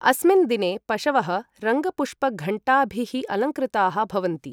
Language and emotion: Sanskrit, neutral